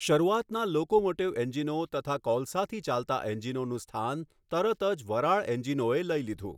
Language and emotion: Gujarati, neutral